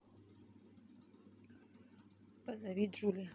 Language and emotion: Russian, neutral